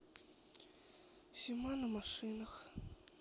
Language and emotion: Russian, sad